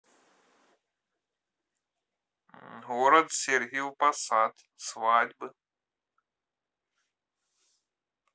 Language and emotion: Russian, neutral